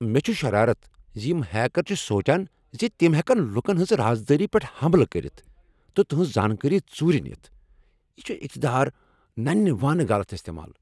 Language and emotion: Kashmiri, angry